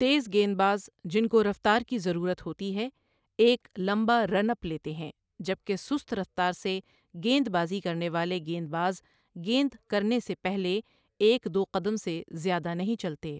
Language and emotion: Urdu, neutral